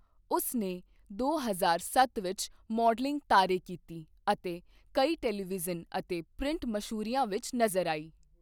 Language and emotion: Punjabi, neutral